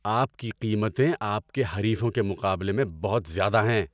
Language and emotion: Urdu, angry